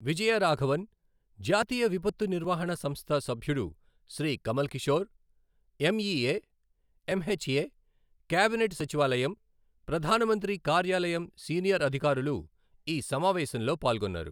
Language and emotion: Telugu, neutral